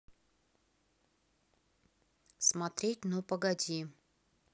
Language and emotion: Russian, neutral